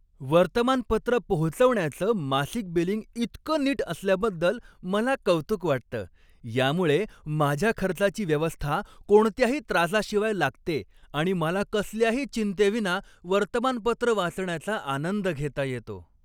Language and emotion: Marathi, happy